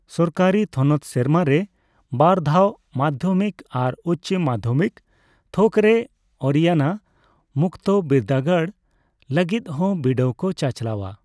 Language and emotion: Santali, neutral